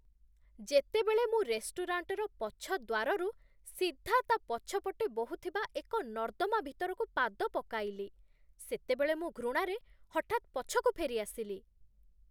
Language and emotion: Odia, disgusted